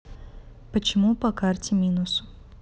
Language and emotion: Russian, neutral